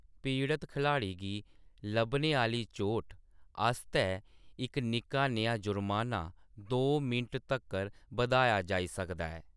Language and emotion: Dogri, neutral